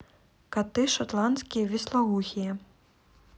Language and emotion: Russian, neutral